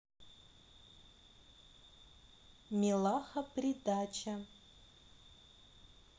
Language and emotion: Russian, neutral